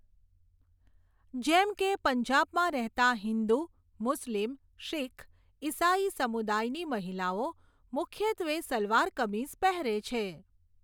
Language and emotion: Gujarati, neutral